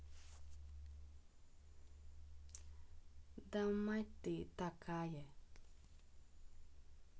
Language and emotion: Russian, neutral